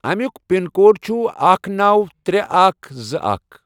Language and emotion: Kashmiri, neutral